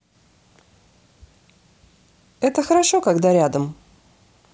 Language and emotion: Russian, positive